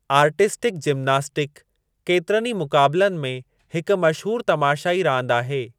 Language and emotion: Sindhi, neutral